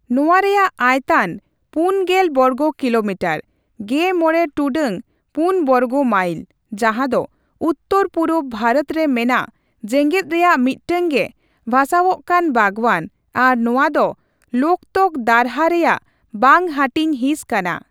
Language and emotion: Santali, neutral